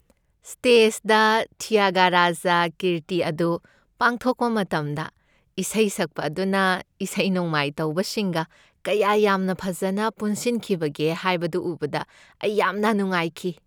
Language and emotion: Manipuri, happy